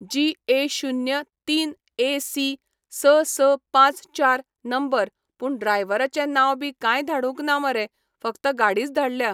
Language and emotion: Goan Konkani, neutral